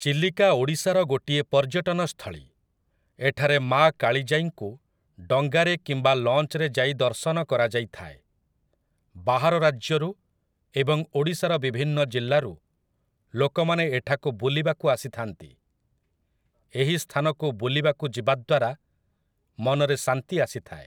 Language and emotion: Odia, neutral